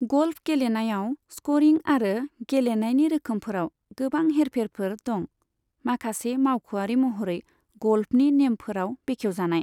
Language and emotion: Bodo, neutral